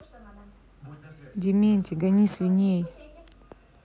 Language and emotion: Russian, neutral